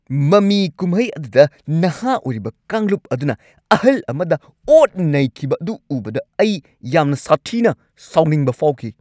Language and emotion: Manipuri, angry